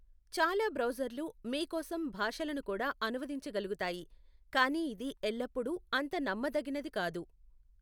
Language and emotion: Telugu, neutral